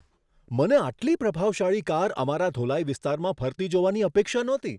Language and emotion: Gujarati, surprised